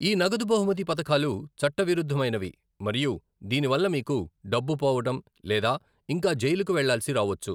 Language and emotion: Telugu, neutral